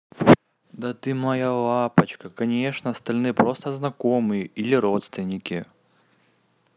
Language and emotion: Russian, positive